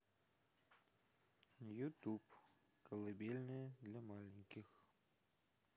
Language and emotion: Russian, neutral